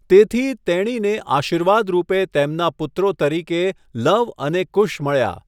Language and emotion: Gujarati, neutral